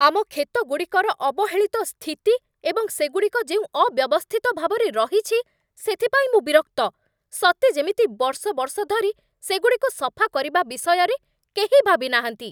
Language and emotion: Odia, angry